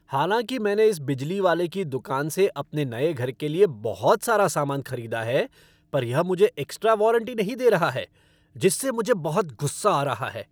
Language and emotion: Hindi, angry